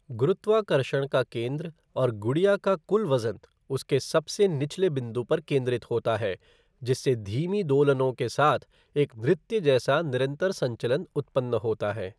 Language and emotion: Hindi, neutral